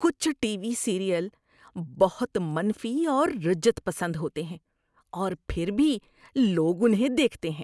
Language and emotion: Urdu, disgusted